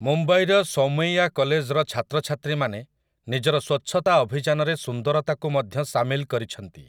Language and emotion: Odia, neutral